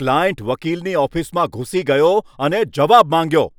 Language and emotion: Gujarati, angry